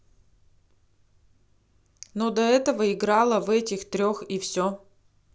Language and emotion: Russian, neutral